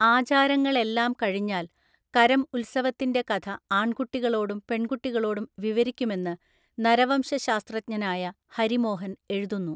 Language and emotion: Malayalam, neutral